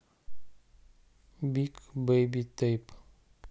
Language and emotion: Russian, neutral